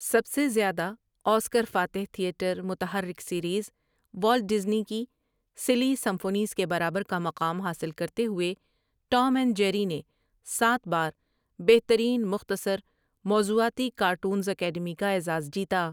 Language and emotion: Urdu, neutral